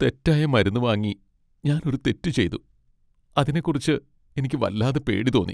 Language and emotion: Malayalam, sad